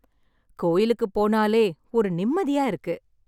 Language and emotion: Tamil, happy